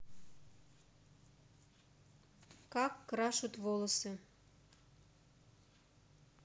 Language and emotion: Russian, neutral